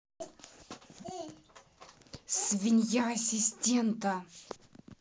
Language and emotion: Russian, angry